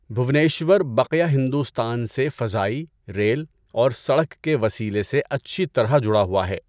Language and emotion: Urdu, neutral